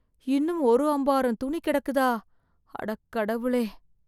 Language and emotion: Tamil, fearful